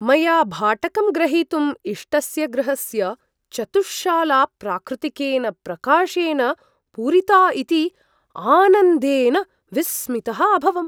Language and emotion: Sanskrit, surprised